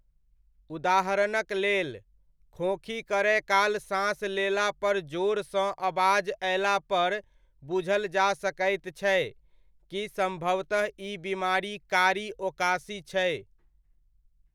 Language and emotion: Maithili, neutral